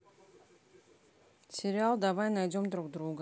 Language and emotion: Russian, neutral